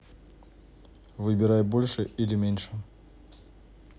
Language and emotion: Russian, neutral